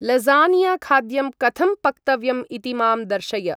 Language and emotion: Sanskrit, neutral